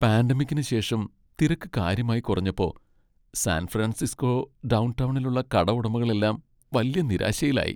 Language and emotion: Malayalam, sad